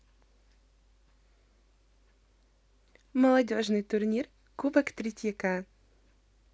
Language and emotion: Russian, positive